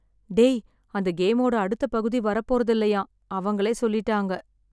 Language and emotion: Tamil, sad